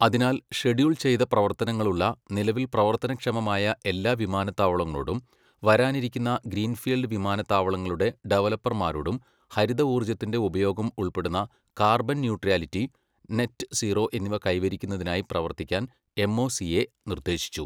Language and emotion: Malayalam, neutral